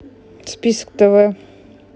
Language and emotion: Russian, neutral